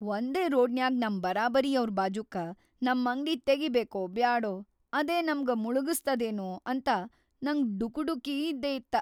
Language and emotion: Kannada, fearful